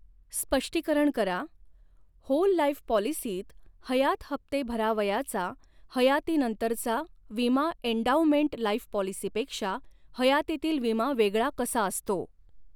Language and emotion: Marathi, neutral